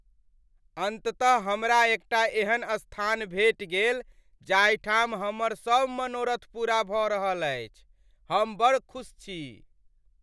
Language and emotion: Maithili, happy